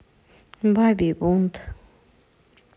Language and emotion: Russian, neutral